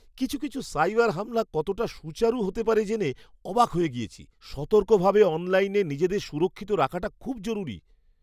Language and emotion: Bengali, surprised